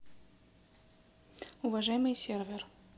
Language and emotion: Russian, neutral